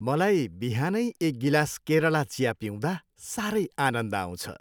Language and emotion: Nepali, happy